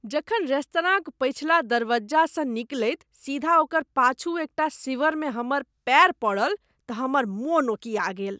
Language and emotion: Maithili, disgusted